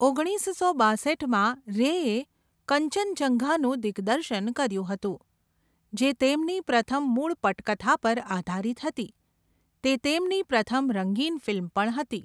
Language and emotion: Gujarati, neutral